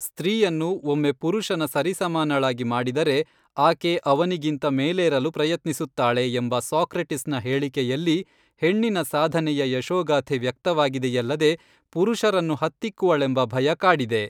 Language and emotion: Kannada, neutral